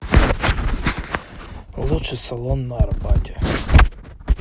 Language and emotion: Russian, neutral